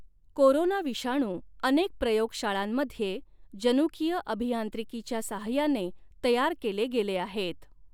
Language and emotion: Marathi, neutral